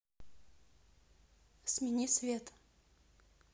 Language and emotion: Russian, neutral